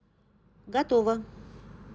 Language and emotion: Russian, neutral